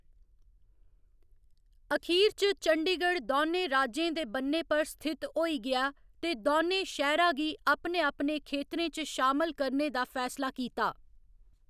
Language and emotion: Dogri, neutral